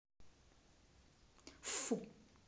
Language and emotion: Russian, angry